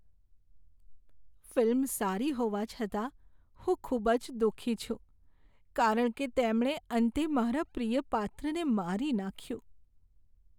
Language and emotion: Gujarati, sad